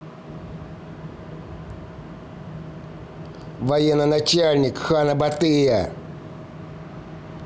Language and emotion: Russian, angry